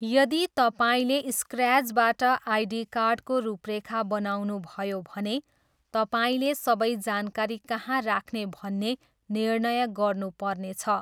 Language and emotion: Nepali, neutral